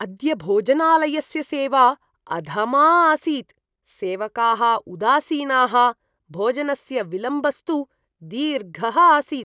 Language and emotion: Sanskrit, disgusted